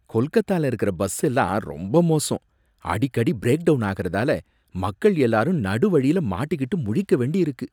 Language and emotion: Tamil, disgusted